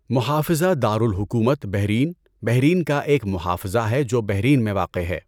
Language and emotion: Urdu, neutral